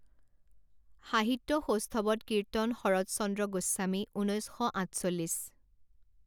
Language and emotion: Assamese, neutral